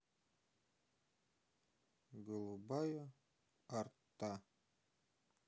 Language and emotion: Russian, neutral